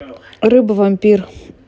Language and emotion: Russian, neutral